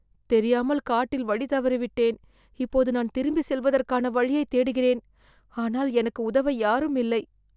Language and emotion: Tamil, fearful